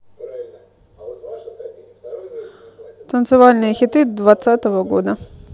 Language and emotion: Russian, neutral